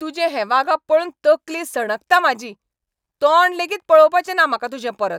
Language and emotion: Goan Konkani, angry